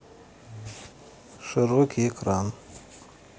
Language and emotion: Russian, neutral